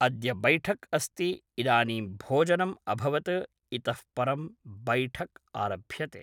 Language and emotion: Sanskrit, neutral